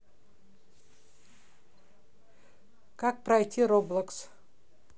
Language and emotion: Russian, neutral